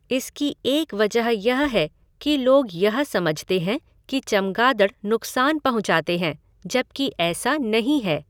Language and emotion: Hindi, neutral